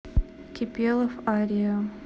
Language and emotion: Russian, neutral